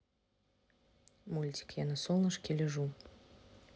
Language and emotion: Russian, neutral